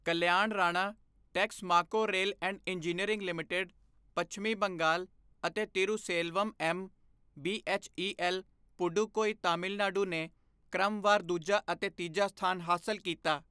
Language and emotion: Punjabi, neutral